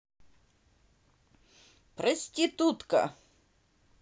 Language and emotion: Russian, neutral